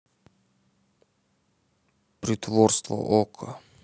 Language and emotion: Russian, neutral